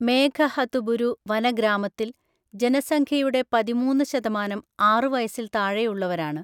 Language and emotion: Malayalam, neutral